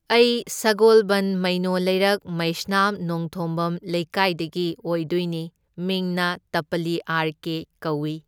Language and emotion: Manipuri, neutral